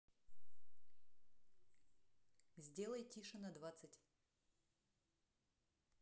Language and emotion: Russian, neutral